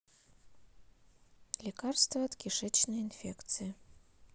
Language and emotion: Russian, neutral